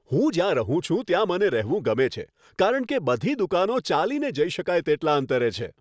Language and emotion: Gujarati, happy